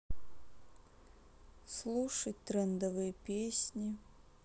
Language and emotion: Russian, sad